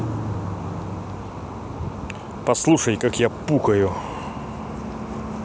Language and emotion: Russian, neutral